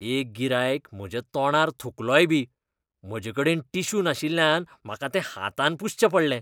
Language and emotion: Goan Konkani, disgusted